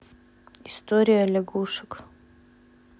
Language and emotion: Russian, neutral